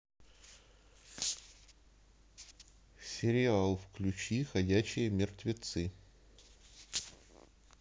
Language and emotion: Russian, neutral